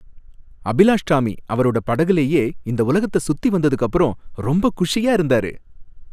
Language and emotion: Tamil, happy